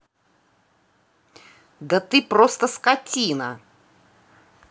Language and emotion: Russian, angry